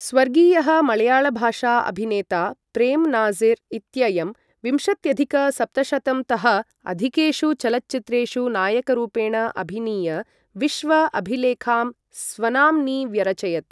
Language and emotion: Sanskrit, neutral